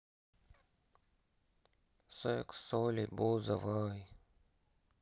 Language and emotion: Russian, sad